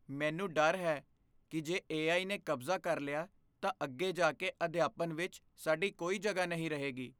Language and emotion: Punjabi, fearful